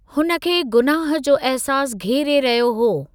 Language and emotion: Sindhi, neutral